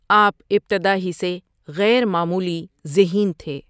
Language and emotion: Urdu, neutral